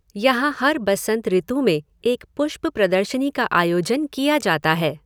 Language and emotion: Hindi, neutral